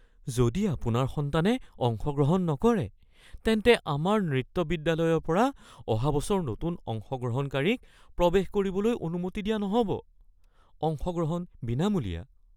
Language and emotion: Assamese, fearful